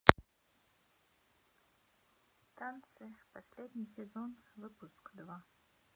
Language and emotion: Russian, neutral